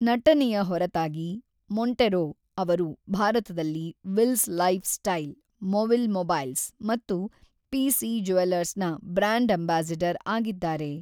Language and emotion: Kannada, neutral